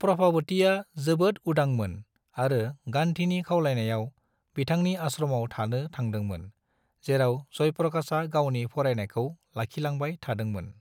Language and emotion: Bodo, neutral